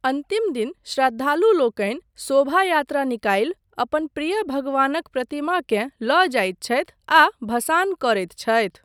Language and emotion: Maithili, neutral